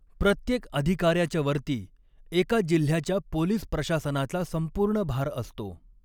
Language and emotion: Marathi, neutral